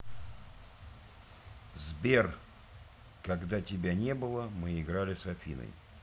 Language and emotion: Russian, neutral